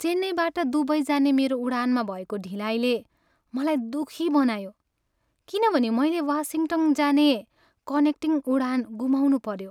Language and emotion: Nepali, sad